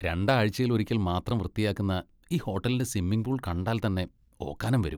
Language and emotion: Malayalam, disgusted